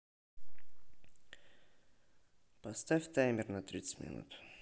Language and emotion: Russian, neutral